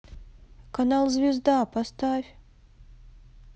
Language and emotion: Russian, sad